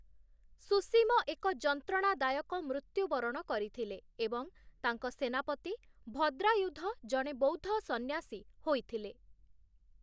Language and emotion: Odia, neutral